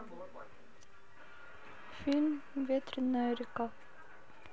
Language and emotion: Russian, neutral